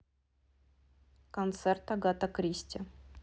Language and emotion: Russian, neutral